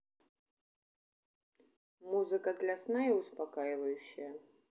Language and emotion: Russian, neutral